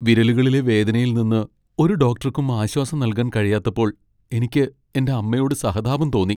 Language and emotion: Malayalam, sad